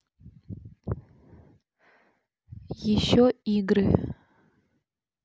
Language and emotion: Russian, neutral